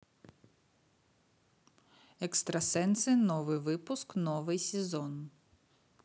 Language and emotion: Russian, neutral